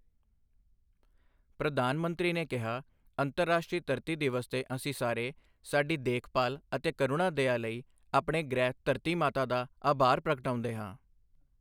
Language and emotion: Punjabi, neutral